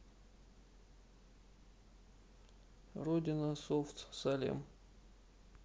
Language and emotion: Russian, neutral